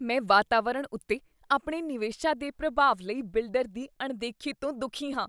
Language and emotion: Punjabi, disgusted